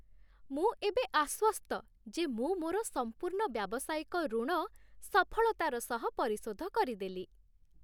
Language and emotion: Odia, happy